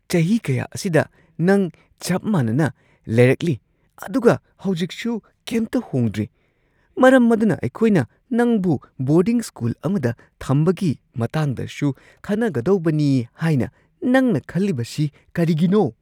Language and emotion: Manipuri, surprised